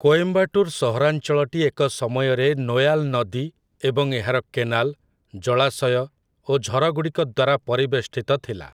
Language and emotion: Odia, neutral